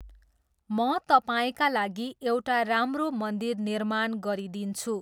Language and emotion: Nepali, neutral